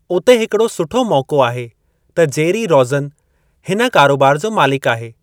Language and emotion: Sindhi, neutral